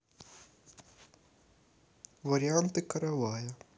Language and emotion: Russian, neutral